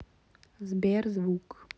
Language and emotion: Russian, neutral